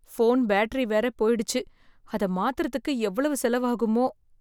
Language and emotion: Tamil, fearful